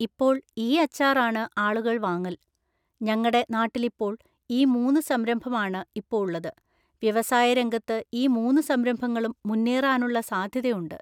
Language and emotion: Malayalam, neutral